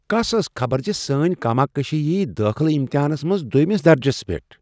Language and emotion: Kashmiri, surprised